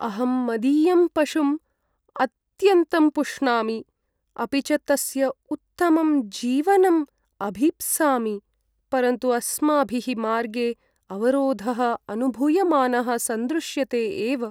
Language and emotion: Sanskrit, sad